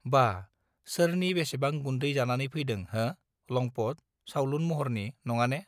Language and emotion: Bodo, neutral